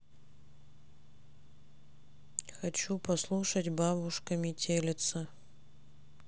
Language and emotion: Russian, neutral